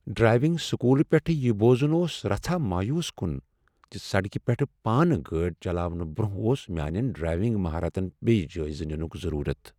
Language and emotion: Kashmiri, sad